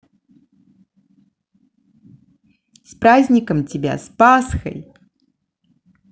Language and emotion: Russian, positive